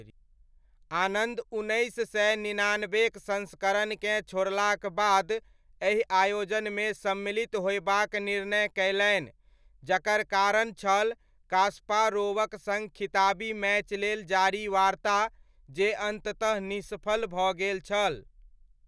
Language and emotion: Maithili, neutral